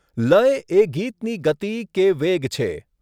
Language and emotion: Gujarati, neutral